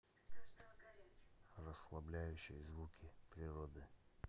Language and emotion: Russian, neutral